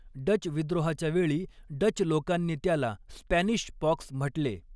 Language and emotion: Marathi, neutral